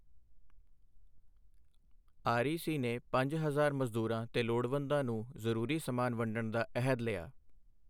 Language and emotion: Punjabi, neutral